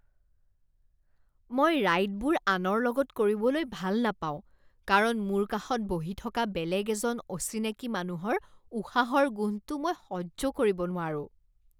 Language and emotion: Assamese, disgusted